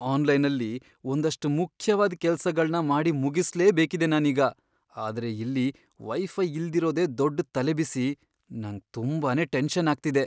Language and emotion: Kannada, fearful